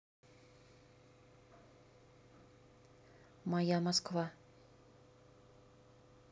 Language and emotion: Russian, neutral